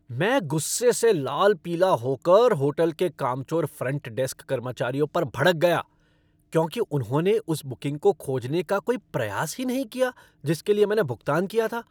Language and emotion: Hindi, angry